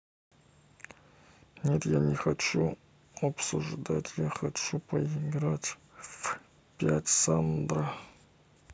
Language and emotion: Russian, neutral